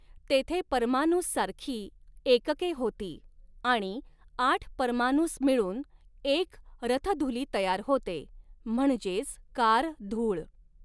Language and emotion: Marathi, neutral